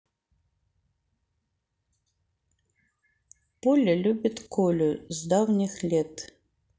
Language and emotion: Russian, neutral